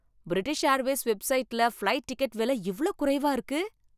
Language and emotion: Tamil, happy